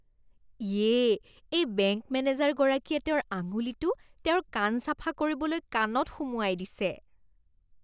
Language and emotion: Assamese, disgusted